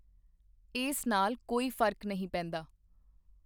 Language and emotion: Punjabi, neutral